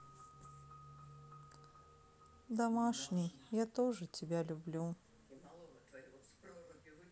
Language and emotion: Russian, sad